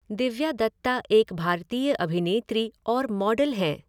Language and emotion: Hindi, neutral